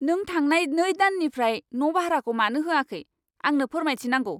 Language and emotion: Bodo, angry